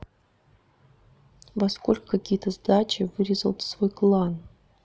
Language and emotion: Russian, neutral